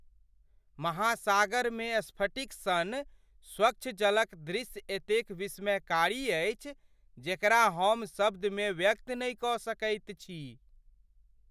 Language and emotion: Maithili, surprised